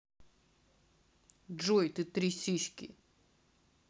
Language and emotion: Russian, neutral